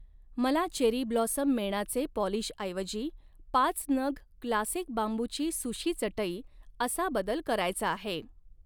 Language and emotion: Marathi, neutral